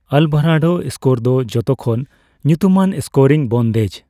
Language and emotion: Santali, neutral